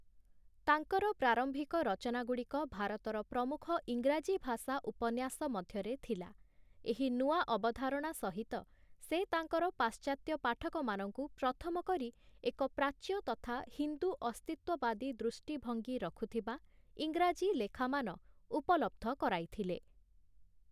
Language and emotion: Odia, neutral